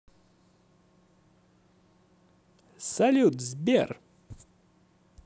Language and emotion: Russian, positive